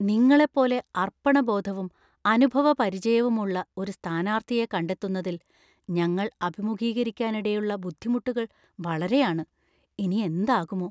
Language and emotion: Malayalam, fearful